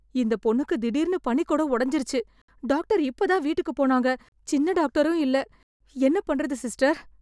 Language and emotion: Tamil, fearful